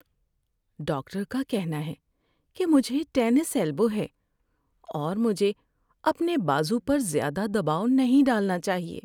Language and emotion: Urdu, sad